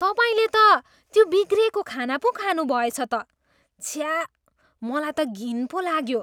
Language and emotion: Nepali, disgusted